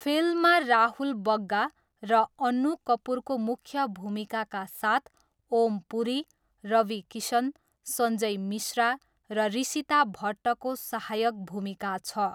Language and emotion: Nepali, neutral